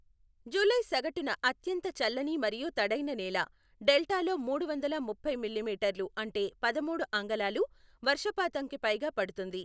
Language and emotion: Telugu, neutral